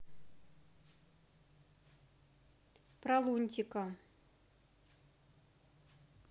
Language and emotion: Russian, neutral